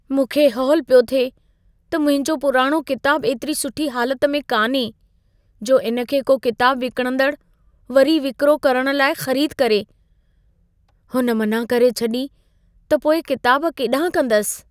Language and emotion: Sindhi, fearful